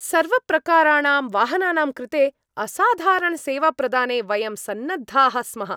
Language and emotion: Sanskrit, happy